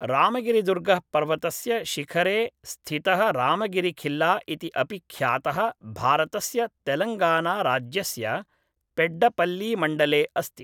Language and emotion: Sanskrit, neutral